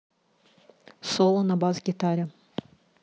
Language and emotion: Russian, neutral